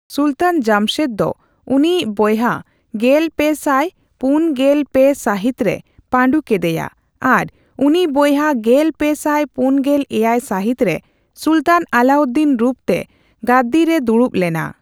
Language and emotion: Santali, neutral